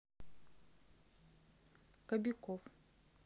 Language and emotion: Russian, neutral